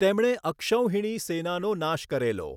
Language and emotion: Gujarati, neutral